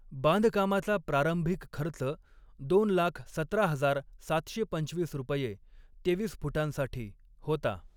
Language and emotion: Marathi, neutral